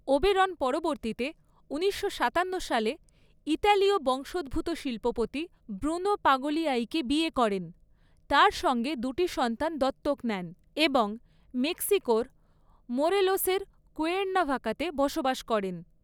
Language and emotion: Bengali, neutral